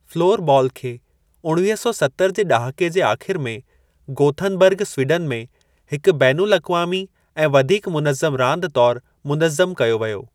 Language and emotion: Sindhi, neutral